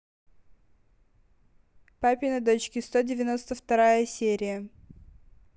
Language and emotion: Russian, neutral